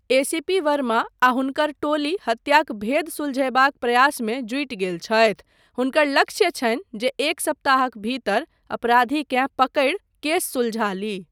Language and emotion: Maithili, neutral